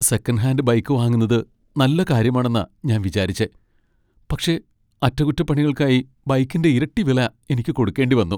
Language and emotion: Malayalam, sad